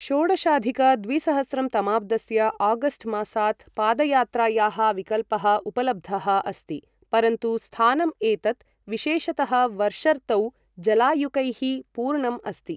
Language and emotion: Sanskrit, neutral